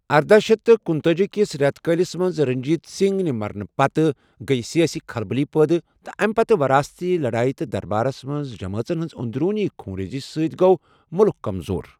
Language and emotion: Kashmiri, neutral